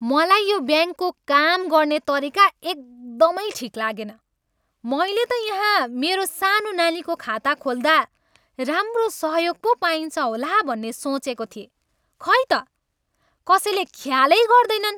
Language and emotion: Nepali, angry